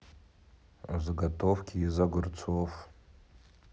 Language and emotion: Russian, neutral